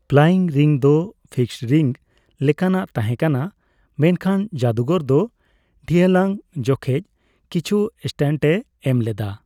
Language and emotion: Santali, neutral